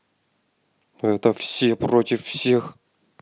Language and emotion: Russian, angry